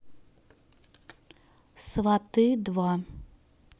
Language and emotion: Russian, neutral